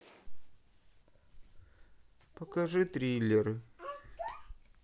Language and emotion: Russian, sad